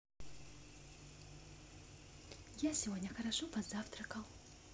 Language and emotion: Russian, positive